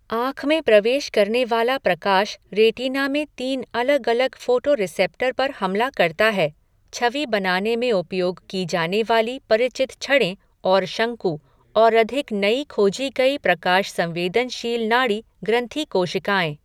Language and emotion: Hindi, neutral